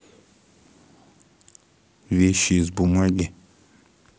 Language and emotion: Russian, neutral